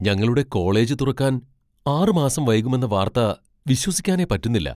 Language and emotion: Malayalam, surprised